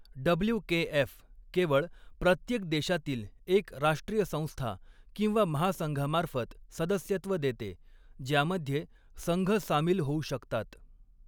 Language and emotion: Marathi, neutral